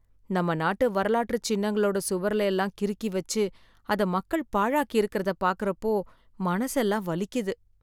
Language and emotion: Tamil, sad